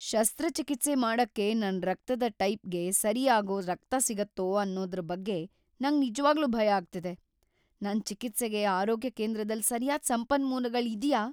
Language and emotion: Kannada, fearful